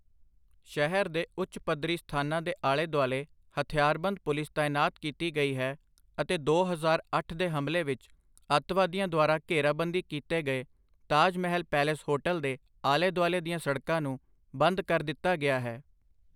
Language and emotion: Punjabi, neutral